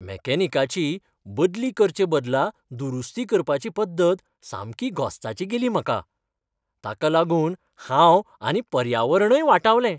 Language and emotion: Goan Konkani, happy